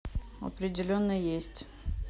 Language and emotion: Russian, neutral